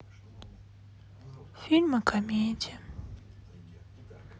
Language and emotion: Russian, sad